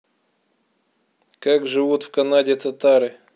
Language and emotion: Russian, neutral